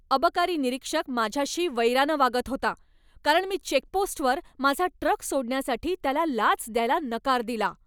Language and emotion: Marathi, angry